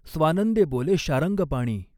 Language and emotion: Marathi, neutral